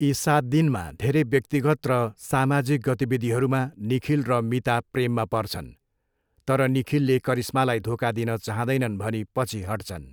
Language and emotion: Nepali, neutral